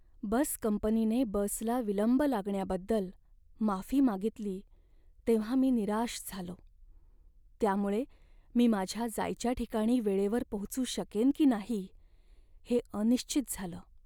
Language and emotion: Marathi, sad